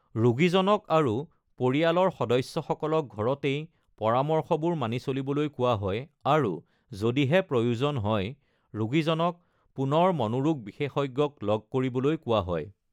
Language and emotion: Assamese, neutral